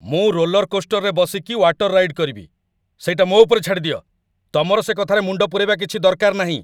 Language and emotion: Odia, angry